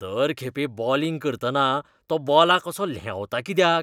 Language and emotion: Goan Konkani, disgusted